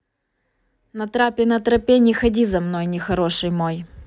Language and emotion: Russian, neutral